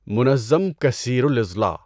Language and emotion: Urdu, neutral